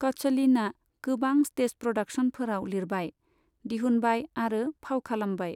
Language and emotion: Bodo, neutral